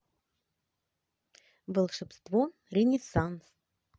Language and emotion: Russian, positive